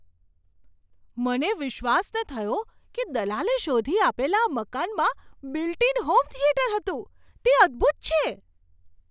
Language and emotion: Gujarati, surprised